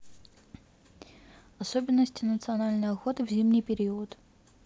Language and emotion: Russian, neutral